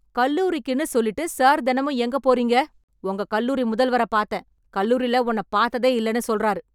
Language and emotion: Tamil, angry